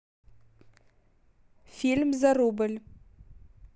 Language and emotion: Russian, neutral